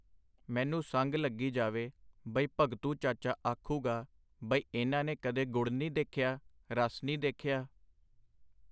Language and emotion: Punjabi, neutral